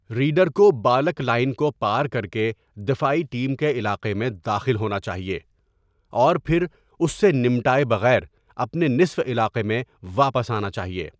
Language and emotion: Urdu, neutral